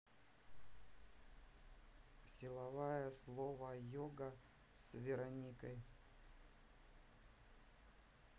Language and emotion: Russian, neutral